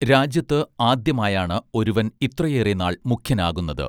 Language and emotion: Malayalam, neutral